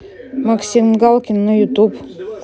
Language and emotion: Russian, neutral